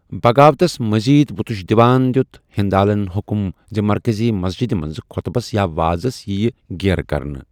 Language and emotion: Kashmiri, neutral